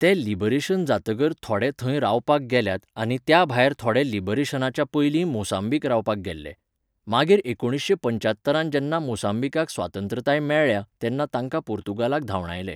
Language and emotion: Goan Konkani, neutral